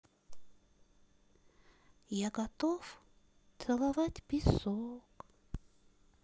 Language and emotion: Russian, sad